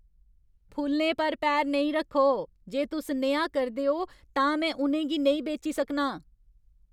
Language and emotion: Dogri, angry